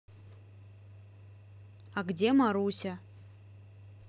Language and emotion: Russian, neutral